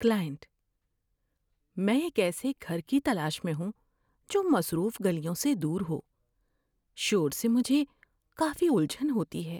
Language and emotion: Urdu, fearful